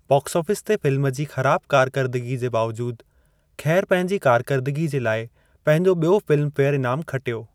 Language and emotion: Sindhi, neutral